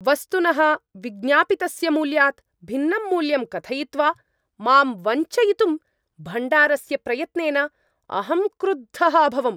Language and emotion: Sanskrit, angry